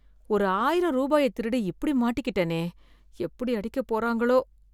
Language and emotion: Tamil, fearful